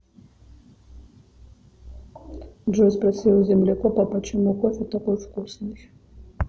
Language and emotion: Russian, neutral